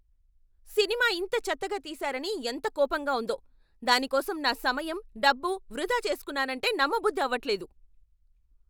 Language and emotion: Telugu, angry